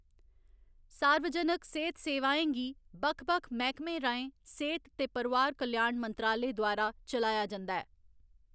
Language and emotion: Dogri, neutral